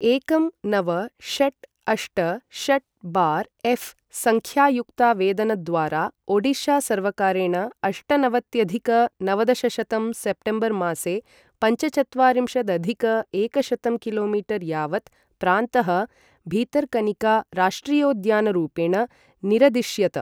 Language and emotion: Sanskrit, neutral